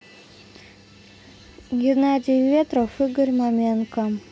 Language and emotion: Russian, neutral